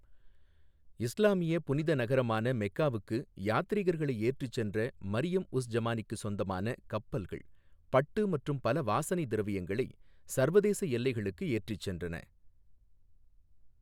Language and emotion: Tamil, neutral